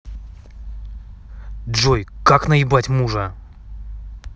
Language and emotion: Russian, angry